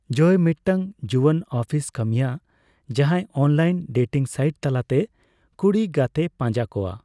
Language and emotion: Santali, neutral